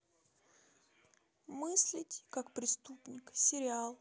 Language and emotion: Russian, neutral